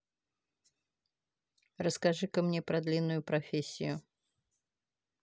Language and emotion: Russian, neutral